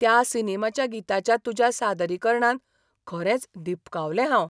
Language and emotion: Goan Konkani, surprised